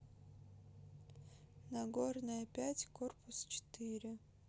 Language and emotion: Russian, neutral